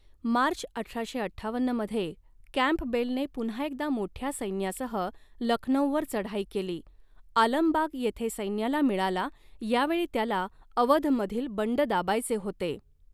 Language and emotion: Marathi, neutral